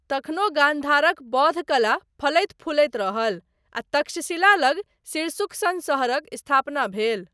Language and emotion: Maithili, neutral